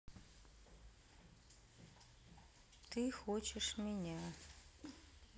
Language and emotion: Russian, sad